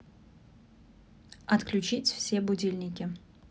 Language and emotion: Russian, neutral